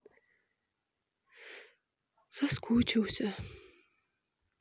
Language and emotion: Russian, sad